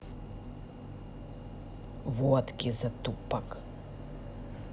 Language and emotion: Russian, angry